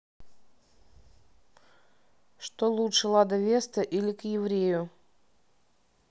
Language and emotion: Russian, neutral